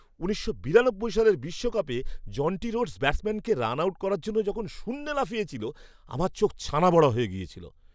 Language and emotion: Bengali, surprised